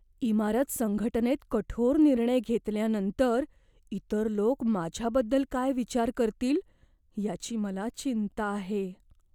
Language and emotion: Marathi, fearful